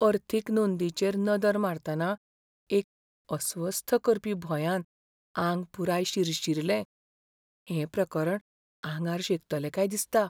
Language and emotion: Goan Konkani, fearful